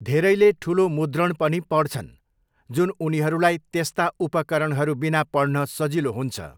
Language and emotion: Nepali, neutral